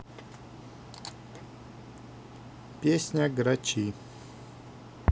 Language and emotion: Russian, neutral